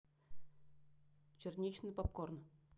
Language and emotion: Russian, neutral